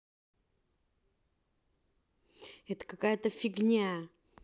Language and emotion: Russian, angry